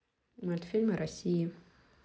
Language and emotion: Russian, neutral